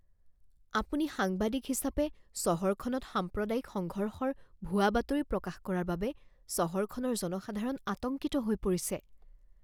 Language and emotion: Assamese, fearful